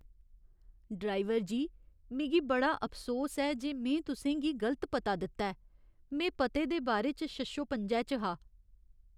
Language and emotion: Dogri, sad